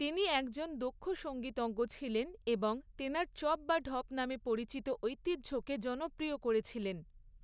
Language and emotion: Bengali, neutral